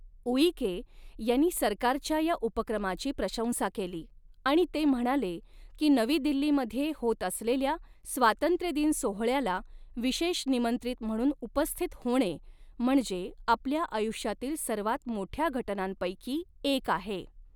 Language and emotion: Marathi, neutral